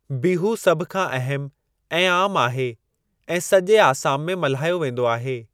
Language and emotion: Sindhi, neutral